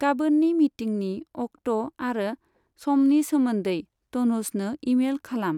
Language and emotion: Bodo, neutral